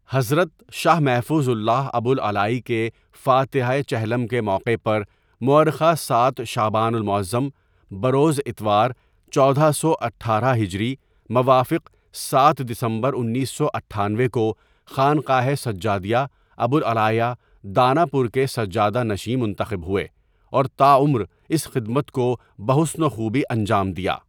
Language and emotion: Urdu, neutral